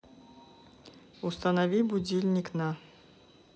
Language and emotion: Russian, neutral